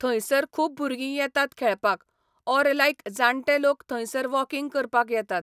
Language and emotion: Goan Konkani, neutral